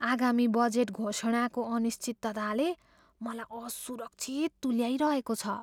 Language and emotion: Nepali, fearful